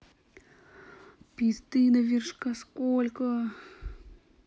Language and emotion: Russian, sad